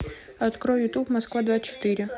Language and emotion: Russian, neutral